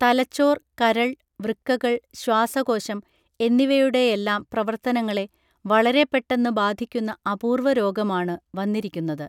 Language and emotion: Malayalam, neutral